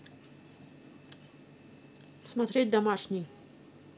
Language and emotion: Russian, neutral